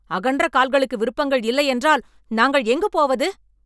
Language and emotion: Tamil, angry